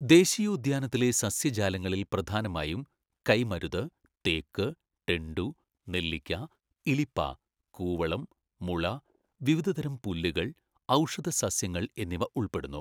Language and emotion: Malayalam, neutral